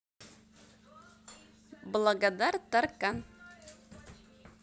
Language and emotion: Russian, positive